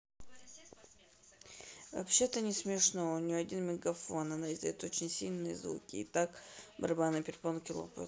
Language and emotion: Russian, neutral